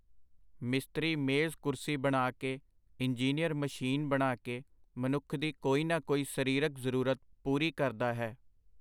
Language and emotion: Punjabi, neutral